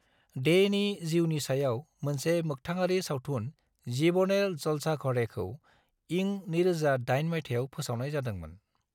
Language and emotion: Bodo, neutral